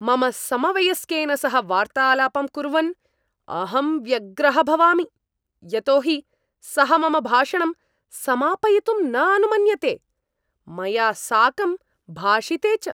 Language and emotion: Sanskrit, angry